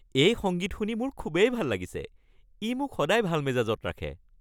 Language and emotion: Assamese, happy